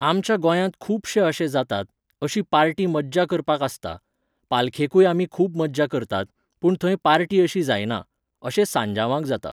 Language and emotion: Goan Konkani, neutral